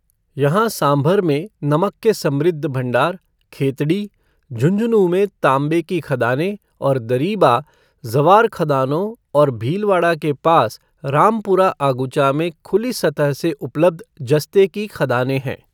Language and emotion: Hindi, neutral